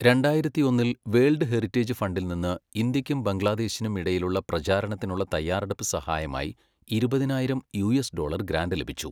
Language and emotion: Malayalam, neutral